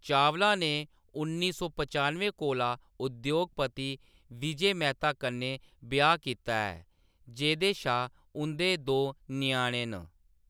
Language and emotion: Dogri, neutral